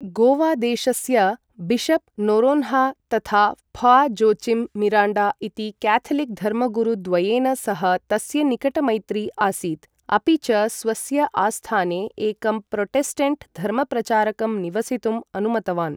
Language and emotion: Sanskrit, neutral